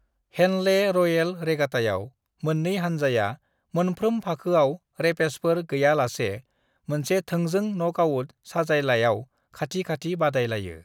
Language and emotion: Bodo, neutral